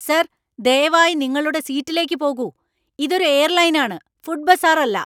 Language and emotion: Malayalam, angry